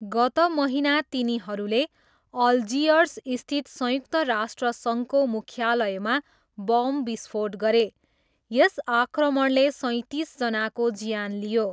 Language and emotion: Nepali, neutral